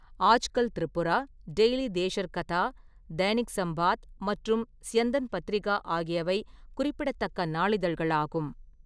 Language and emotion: Tamil, neutral